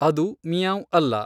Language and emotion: Kannada, neutral